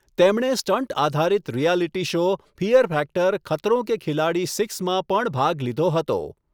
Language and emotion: Gujarati, neutral